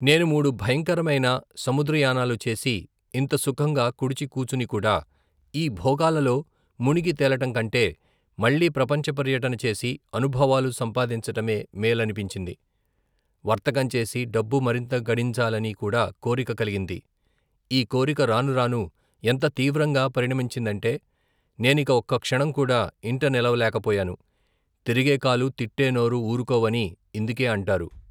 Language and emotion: Telugu, neutral